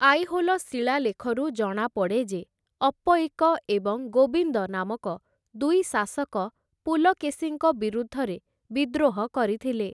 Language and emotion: Odia, neutral